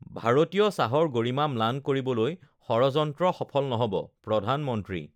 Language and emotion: Assamese, neutral